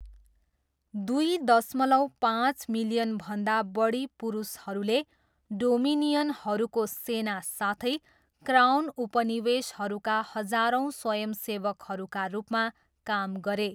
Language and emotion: Nepali, neutral